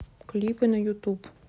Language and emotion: Russian, neutral